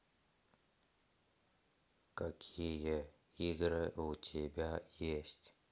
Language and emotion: Russian, neutral